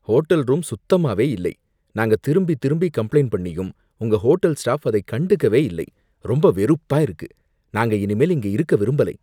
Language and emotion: Tamil, disgusted